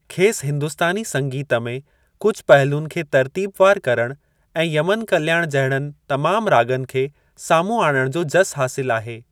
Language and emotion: Sindhi, neutral